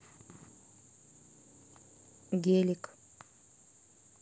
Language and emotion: Russian, neutral